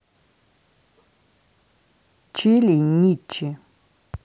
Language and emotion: Russian, neutral